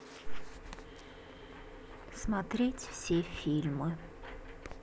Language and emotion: Russian, sad